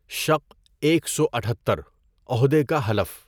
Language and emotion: Urdu, neutral